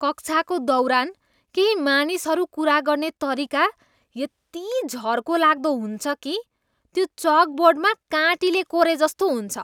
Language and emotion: Nepali, disgusted